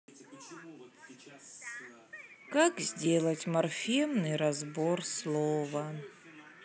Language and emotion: Russian, sad